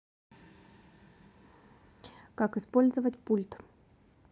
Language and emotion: Russian, neutral